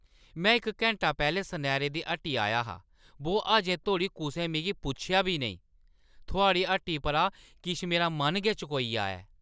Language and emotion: Dogri, angry